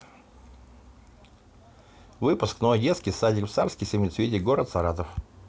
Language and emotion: Russian, neutral